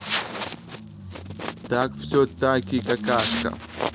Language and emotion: Russian, neutral